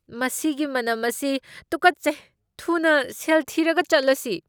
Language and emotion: Manipuri, disgusted